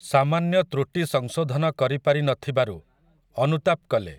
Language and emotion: Odia, neutral